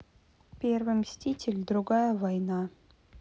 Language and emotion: Russian, neutral